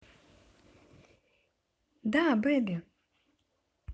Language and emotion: Russian, positive